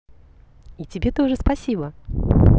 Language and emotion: Russian, positive